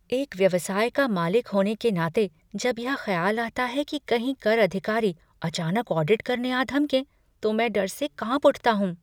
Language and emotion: Hindi, fearful